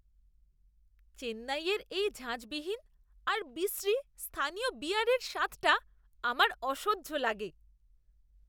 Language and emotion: Bengali, disgusted